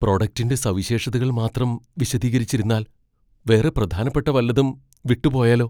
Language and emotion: Malayalam, fearful